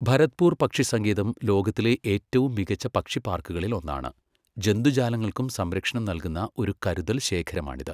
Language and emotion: Malayalam, neutral